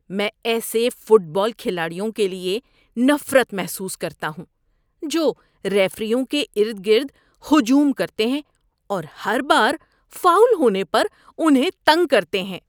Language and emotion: Urdu, disgusted